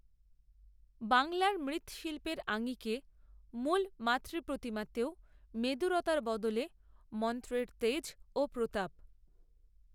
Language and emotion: Bengali, neutral